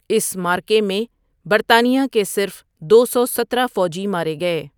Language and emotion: Urdu, neutral